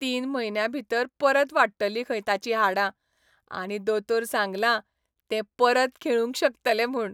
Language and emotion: Goan Konkani, happy